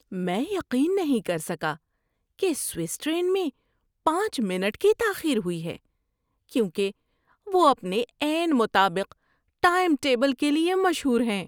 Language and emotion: Urdu, surprised